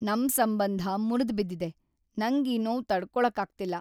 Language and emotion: Kannada, sad